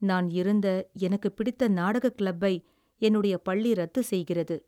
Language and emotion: Tamil, sad